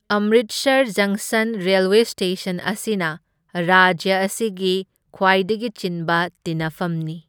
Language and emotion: Manipuri, neutral